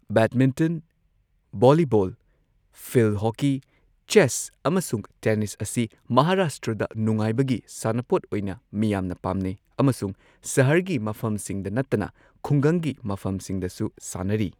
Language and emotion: Manipuri, neutral